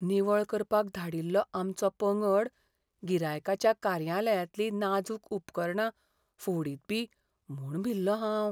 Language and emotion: Goan Konkani, fearful